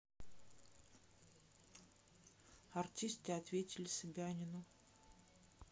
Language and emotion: Russian, neutral